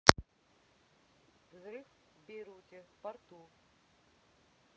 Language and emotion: Russian, neutral